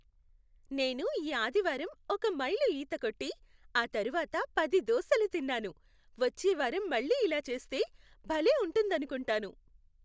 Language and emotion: Telugu, happy